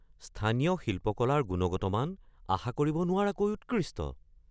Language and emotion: Assamese, surprised